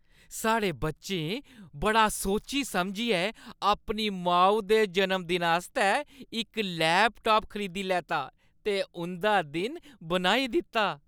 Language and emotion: Dogri, happy